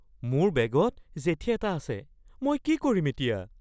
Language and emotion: Assamese, fearful